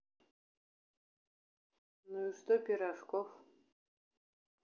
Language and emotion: Russian, neutral